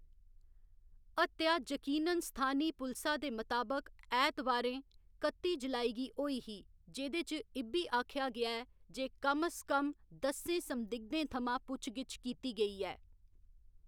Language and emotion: Dogri, neutral